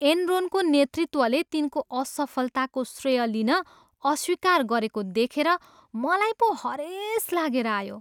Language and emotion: Nepali, disgusted